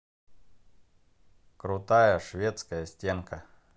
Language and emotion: Russian, positive